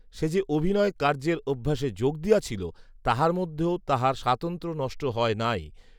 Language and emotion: Bengali, neutral